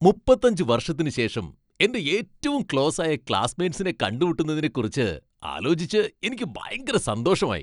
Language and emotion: Malayalam, happy